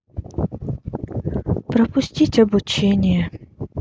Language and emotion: Russian, sad